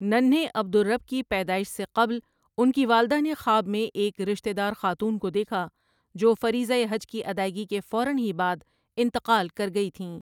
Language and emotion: Urdu, neutral